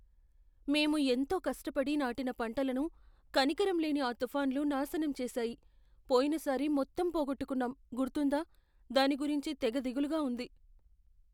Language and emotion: Telugu, fearful